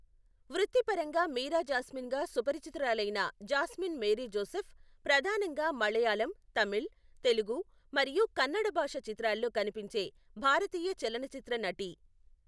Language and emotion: Telugu, neutral